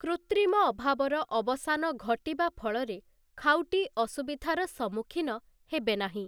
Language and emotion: Odia, neutral